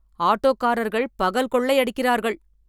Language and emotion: Tamil, angry